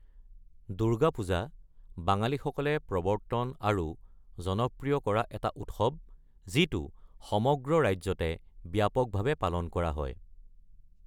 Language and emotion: Assamese, neutral